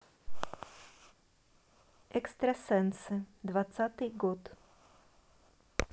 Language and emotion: Russian, neutral